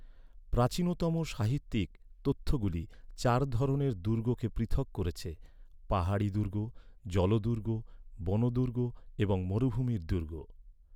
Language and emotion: Bengali, neutral